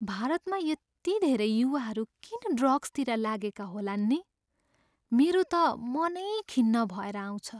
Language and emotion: Nepali, sad